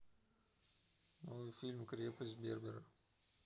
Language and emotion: Russian, neutral